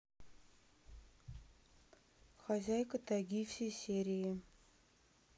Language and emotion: Russian, neutral